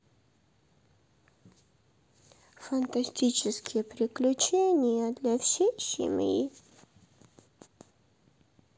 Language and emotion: Russian, sad